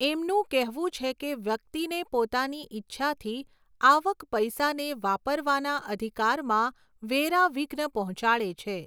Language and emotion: Gujarati, neutral